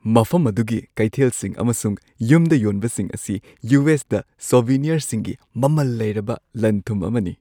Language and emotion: Manipuri, happy